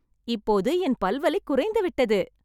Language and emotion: Tamil, happy